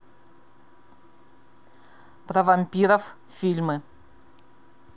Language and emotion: Russian, neutral